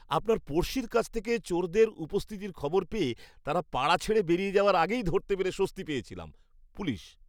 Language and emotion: Bengali, happy